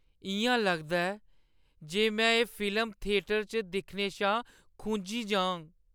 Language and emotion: Dogri, sad